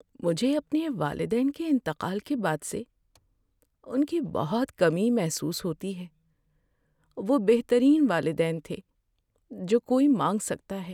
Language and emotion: Urdu, sad